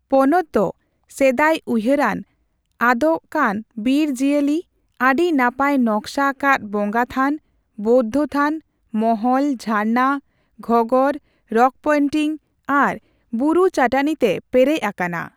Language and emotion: Santali, neutral